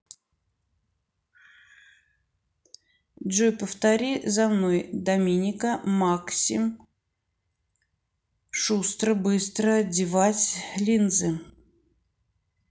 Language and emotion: Russian, neutral